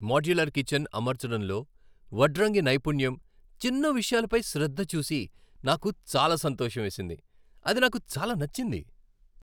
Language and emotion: Telugu, happy